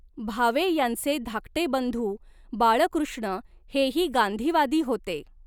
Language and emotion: Marathi, neutral